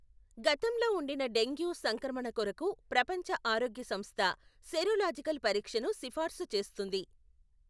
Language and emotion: Telugu, neutral